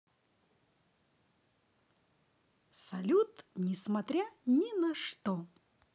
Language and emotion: Russian, positive